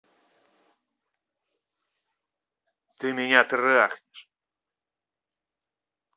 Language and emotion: Russian, angry